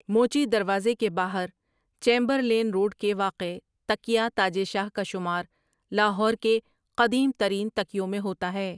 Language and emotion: Urdu, neutral